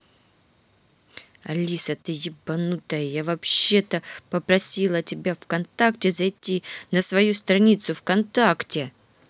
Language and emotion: Russian, angry